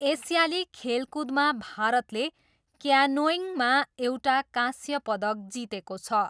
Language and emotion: Nepali, neutral